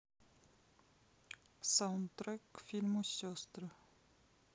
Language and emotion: Russian, neutral